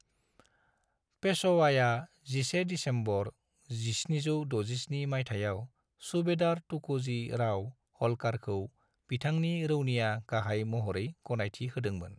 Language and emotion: Bodo, neutral